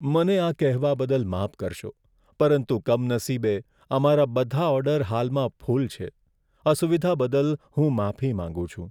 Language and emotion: Gujarati, sad